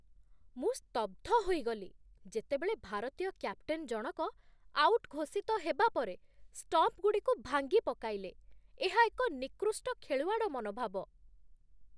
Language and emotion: Odia, disgusted